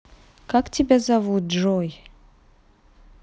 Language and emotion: Russian, neutral